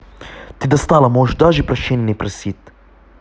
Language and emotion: Russian, angry